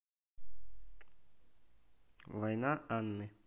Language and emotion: Russian, neutral